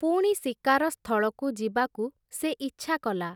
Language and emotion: Odia, neutral